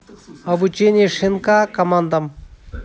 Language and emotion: Russian, neutral